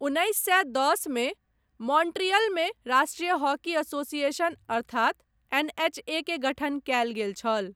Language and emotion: Maithili, neutral